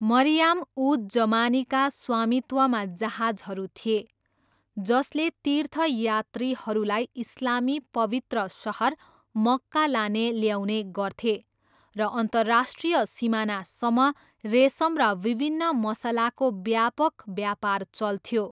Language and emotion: Nepali, neutral